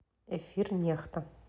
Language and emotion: Russian, neutral